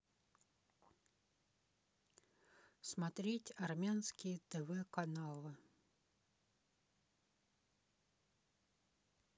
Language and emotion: Russian, neutral